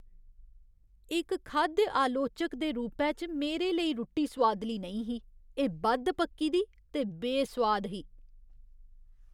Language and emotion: Dogri, disgusted